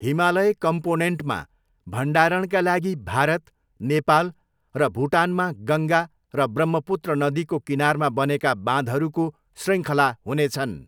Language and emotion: Nepali, neutral